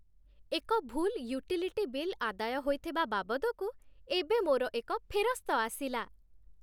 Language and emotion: Odia, happy